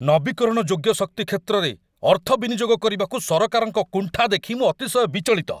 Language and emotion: Odia, angry